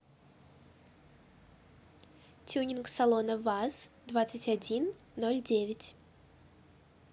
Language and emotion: Russian, positive